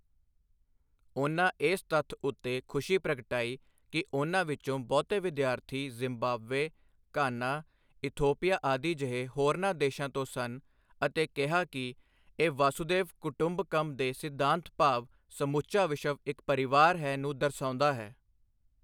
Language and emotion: Punjabi, neutral